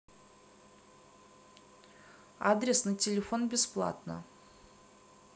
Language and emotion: Russian, neutral